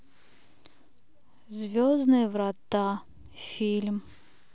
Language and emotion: Russian, sad